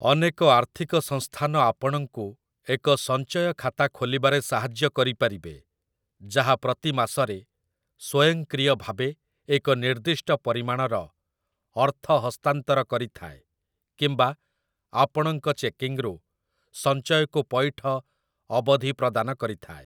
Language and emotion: Odia, neutral